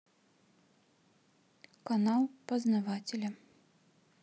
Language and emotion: Russian, neutral